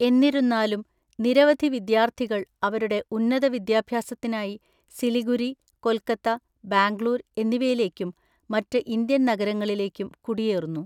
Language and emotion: Malayalam, neutral